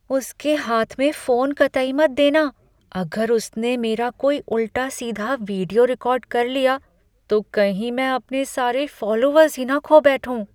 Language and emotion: Hindi, fearful